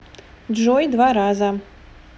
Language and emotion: Russian, neutral